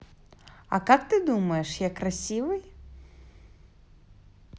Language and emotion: Russian, positive